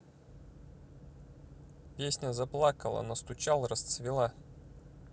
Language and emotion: Russian, neutral